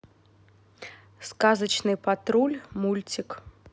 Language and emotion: Russian, neutral